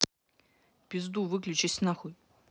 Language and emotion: Russian, angry